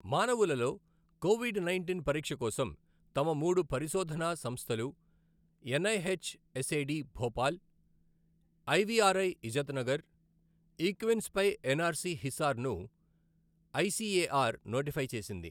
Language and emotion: Telugu, neutral